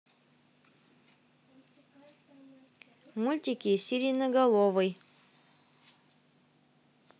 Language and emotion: Russian, neutral